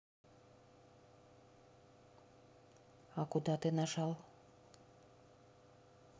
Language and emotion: Russian, neutral